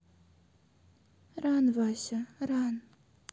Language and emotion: Russian, sad